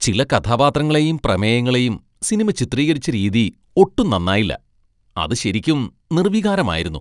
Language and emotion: Malayalam, disgusted